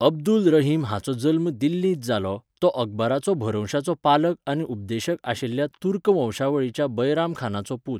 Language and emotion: Goan Konkani, neutral